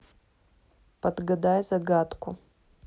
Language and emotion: Russian, neutral